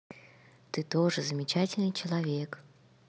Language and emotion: Russian, positive